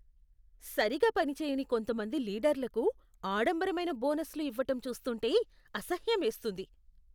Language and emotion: Telugu, disgusted